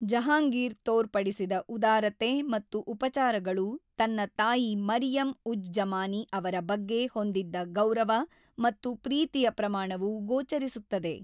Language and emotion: Kannada, neutral